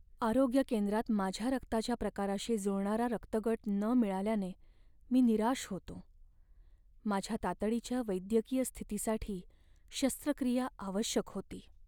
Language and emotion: Marathi, sad